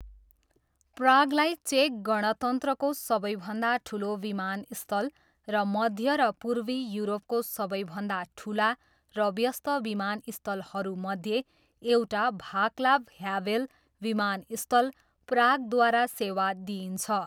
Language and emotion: Nepali, neutral